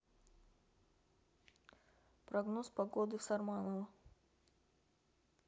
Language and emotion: Russian, neutral